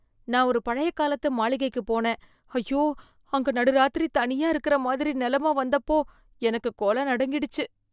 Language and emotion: Tamil, fearful